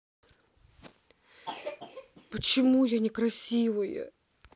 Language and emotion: Russian, sad